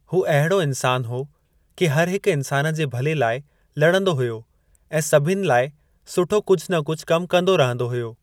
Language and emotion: Sindhi, neutral